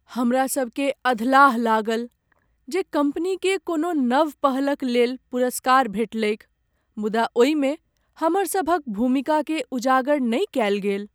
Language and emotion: Maithili, sad